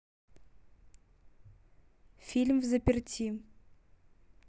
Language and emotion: Russian, neutral